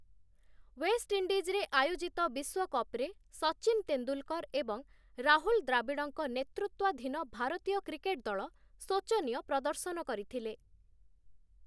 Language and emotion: Odia, neutral